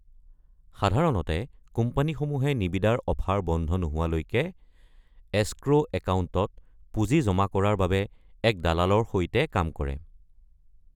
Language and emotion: Assamese, neutral